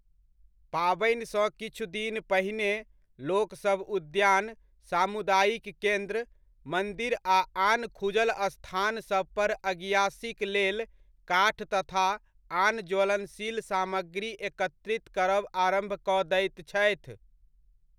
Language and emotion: Maithili, neutral